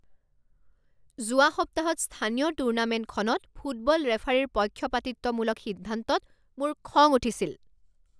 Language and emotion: Assamese, angry